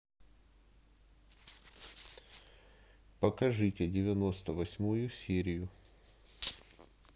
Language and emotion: Russian, neutral